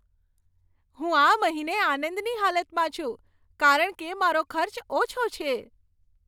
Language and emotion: Gujarati, happy